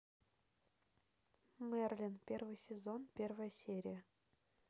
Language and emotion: Russian, neutral